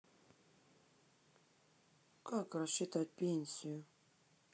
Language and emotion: Russian, sad